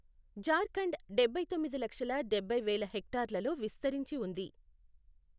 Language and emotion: Telugu, neutral